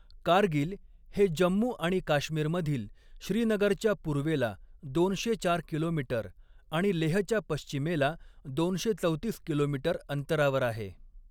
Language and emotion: Marathi, neutral